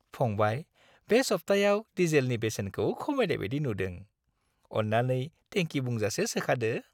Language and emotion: Bodo, happy